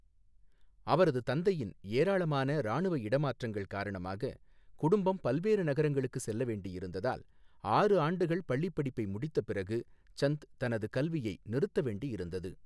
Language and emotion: Tamil, neutral